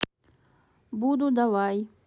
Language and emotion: Russian, neutral